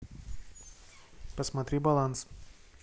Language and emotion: Russian, neutral